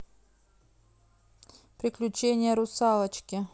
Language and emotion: Russian, neutral